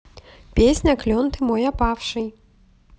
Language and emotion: Russian, positive